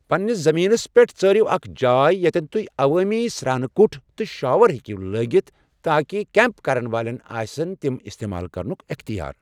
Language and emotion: Kashmiri, neutral